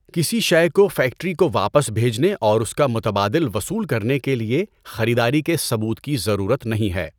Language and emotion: Urdu, neutral